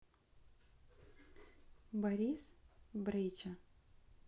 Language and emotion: Russian, neutral